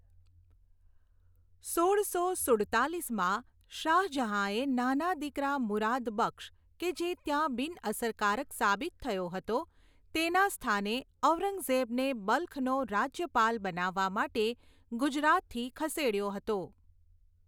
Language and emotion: Gujarati, neutral